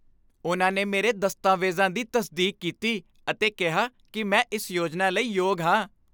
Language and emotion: Punjabi, happy